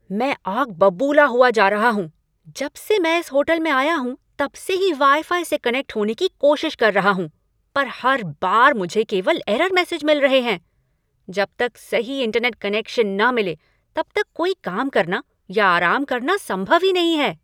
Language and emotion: Hindi, angry